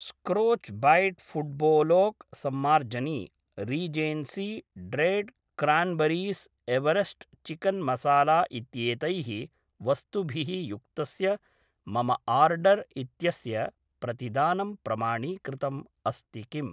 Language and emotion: Sanskrit, neutral